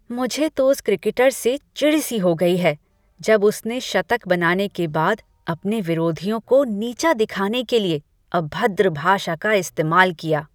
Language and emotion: Hindi, disgusted